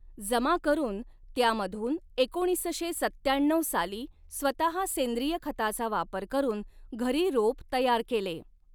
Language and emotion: Marathi, neutral